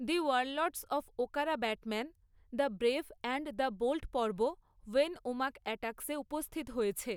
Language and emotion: Bengali, neutral